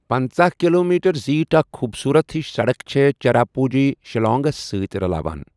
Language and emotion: Kashmiri, neutral